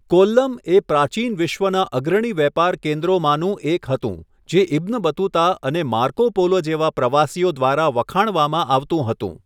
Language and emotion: Gujarati, neutral